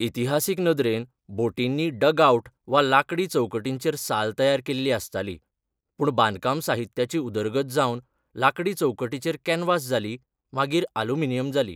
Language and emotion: Goan Konkani, neutral